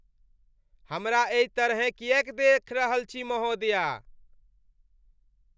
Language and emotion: Maithili, disgusted